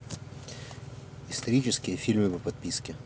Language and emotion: Russian, neutral